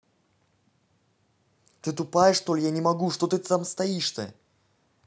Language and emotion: Russian, angry